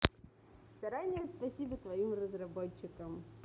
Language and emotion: Russian, positive